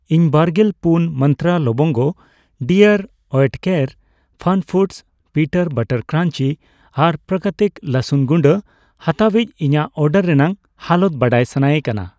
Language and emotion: Santali, neutral